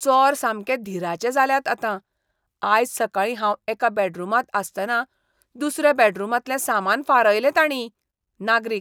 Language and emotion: Goan Konkani, disgusted